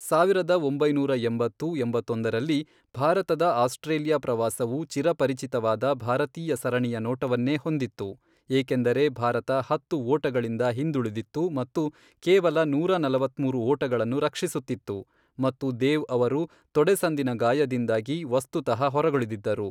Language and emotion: Kannada, neutral